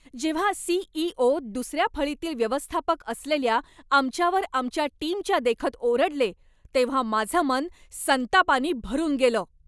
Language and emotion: Marathi, angry